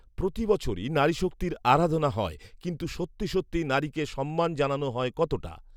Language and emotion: Bengali, neutral